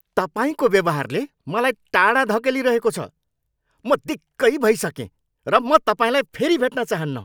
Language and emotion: Nepali, angry